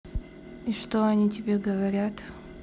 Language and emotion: Russian, neutral